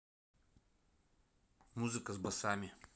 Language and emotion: Russian, neutral